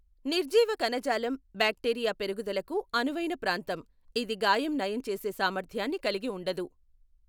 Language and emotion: Telugu, neutral